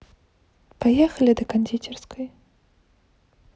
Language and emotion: Russian, neutral